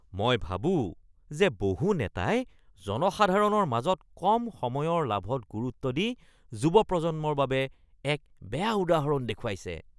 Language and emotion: Assamese, disgusted